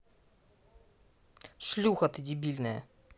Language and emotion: Russian, angry